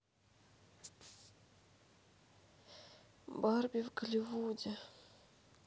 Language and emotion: Russian, sad